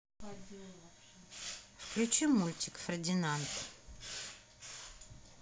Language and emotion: Russian, neutral